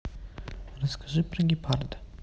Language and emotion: Russian, neutral